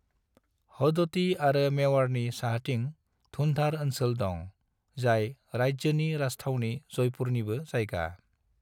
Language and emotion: Bodo, neutral